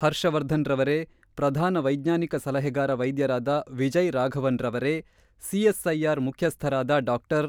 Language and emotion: Kannada, neutral